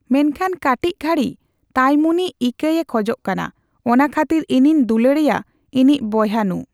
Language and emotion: Santali, neutral